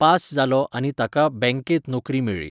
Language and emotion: Goan Konkani, neutral